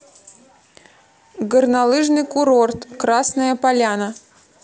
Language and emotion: Russian, neutral